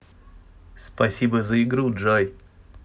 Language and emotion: Russian, positive